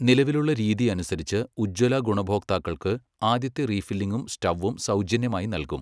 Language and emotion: Malayalam, neutral